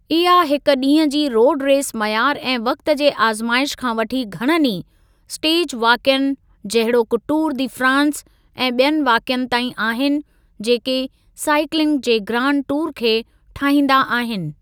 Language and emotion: Sindhi, neutral